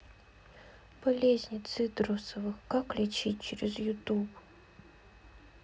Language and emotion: Russian, sad